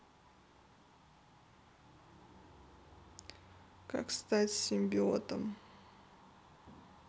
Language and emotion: Russian, sad